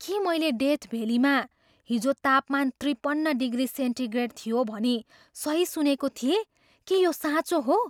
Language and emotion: Nepali, surprised